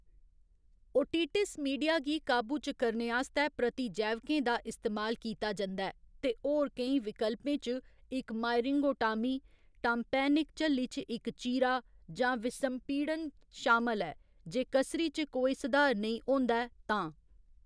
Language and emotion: Dogri, neutral